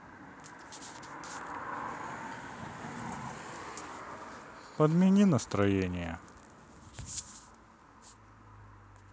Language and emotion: Russian, sad